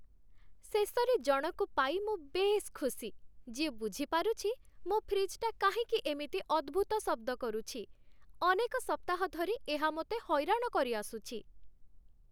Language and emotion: Odia, happy